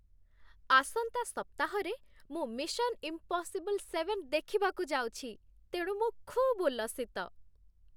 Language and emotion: Odia, happy